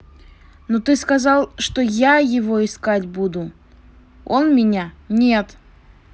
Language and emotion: Russian, angry